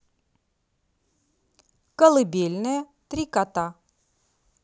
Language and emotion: Russian, positive